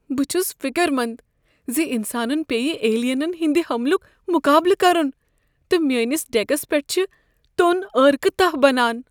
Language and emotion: Kashmiri, fearful